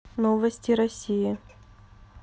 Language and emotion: Russian, neutral